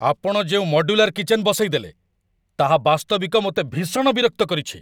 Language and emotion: Odia, angry